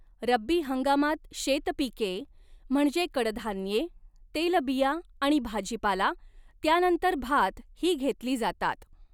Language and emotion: Marathi, neutral